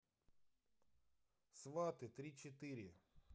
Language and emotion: Russian, neutral